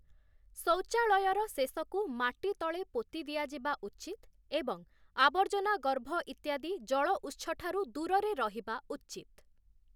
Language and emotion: Odia, neutral